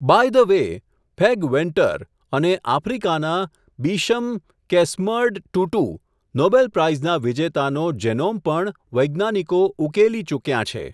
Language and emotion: Gujarati, neutral